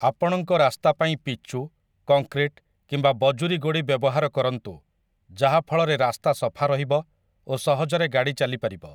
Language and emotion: Odia, neutral